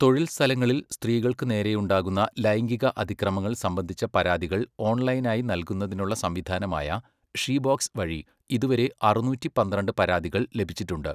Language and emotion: Malayalam, neutral